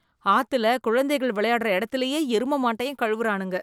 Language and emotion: Tamil, disgusted